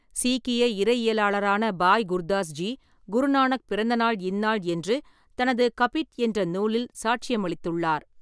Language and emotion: Tamil, neutral